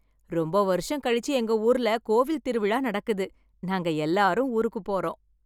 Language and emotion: Tamil, happy